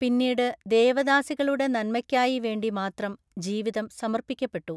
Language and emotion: Malayalam, neutral